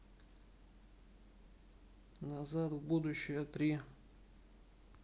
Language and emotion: Russian, neutral